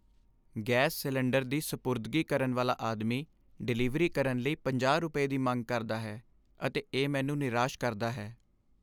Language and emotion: Punjabi, sad